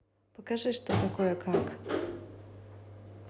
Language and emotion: Russian, neutral